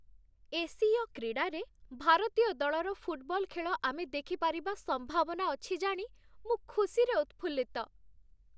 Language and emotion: Odia, happy